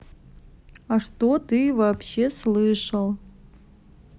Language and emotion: Russian, neutral